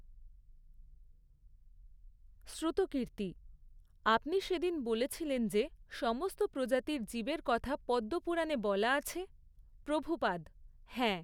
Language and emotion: Bengali, neutral